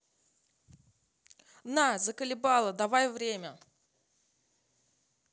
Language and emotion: Russian, angry